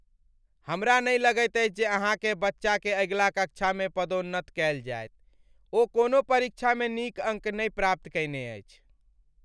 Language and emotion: Maithili, sad